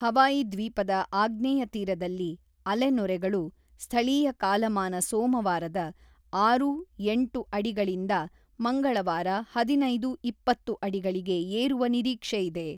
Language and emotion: Kannada, neutral